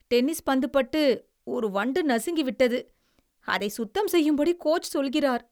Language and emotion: Tamil, disgusted